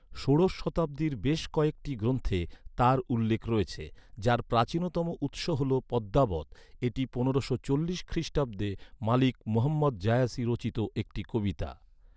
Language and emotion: Bengali, neutral